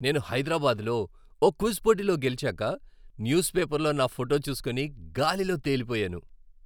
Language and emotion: Telugu, happy